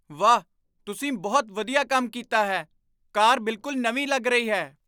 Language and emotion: Punjabi, surprised